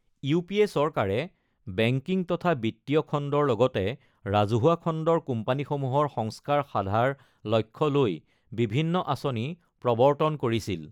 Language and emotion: Assamese, neutral